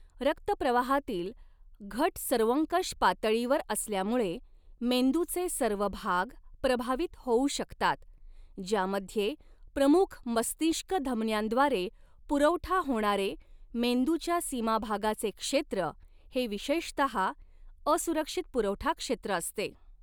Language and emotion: Marathi, neutral